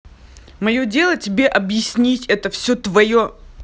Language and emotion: Russian, angry